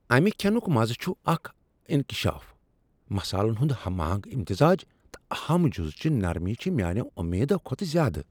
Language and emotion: Kashmiri, surprised